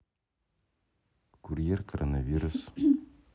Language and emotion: Russian, neutral